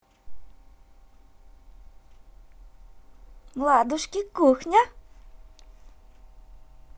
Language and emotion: Russian, positive